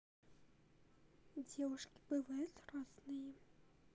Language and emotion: Russian, neutral